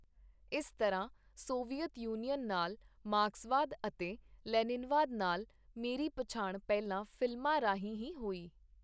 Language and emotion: Punjabi, neutral